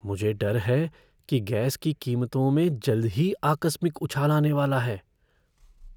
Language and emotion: Hindi, fearful